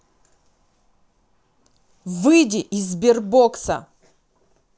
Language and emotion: Russian, angry